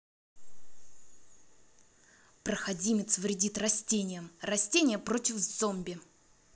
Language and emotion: Russian, angry